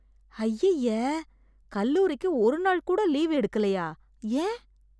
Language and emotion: Tamil, disgusted